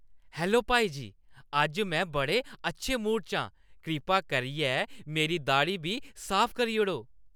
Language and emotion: Dogri, happy